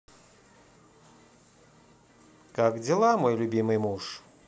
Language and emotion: Russian, positive